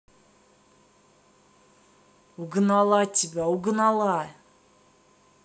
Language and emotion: Russian, angry